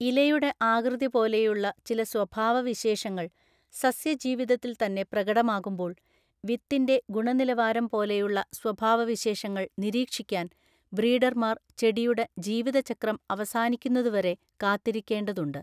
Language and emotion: Malayalam, neutral